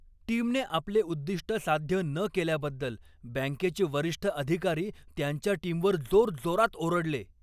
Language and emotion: Marathi, angry